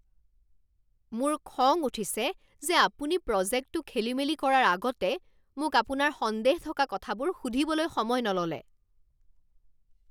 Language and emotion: Assamese, angry